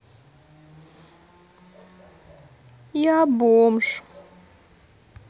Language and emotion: Russian, sad